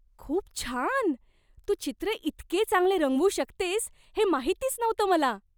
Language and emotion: Marathi, surprised